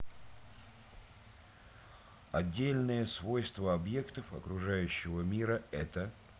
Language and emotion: Russian, neutral